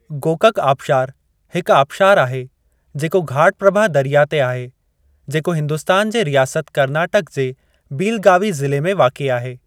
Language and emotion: Sindhi, neutral